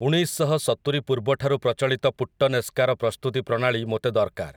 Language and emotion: Odia, neutral